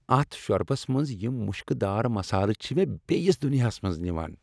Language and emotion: Kashmiri, happy